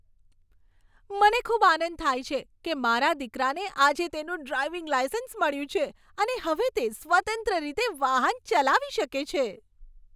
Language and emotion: Gujarati, happy